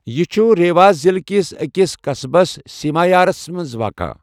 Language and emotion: Kashmiri, neutral